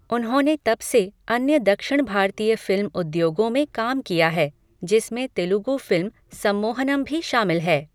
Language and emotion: Hindi, neutral